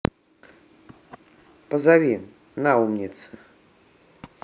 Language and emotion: Russian, neutral